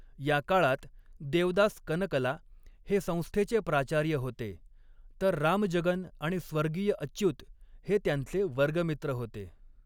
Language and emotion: Marathi, neutral